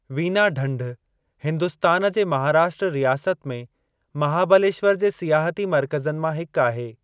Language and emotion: Sindhi, neutral